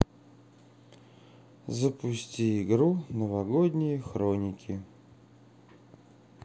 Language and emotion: Russian, sad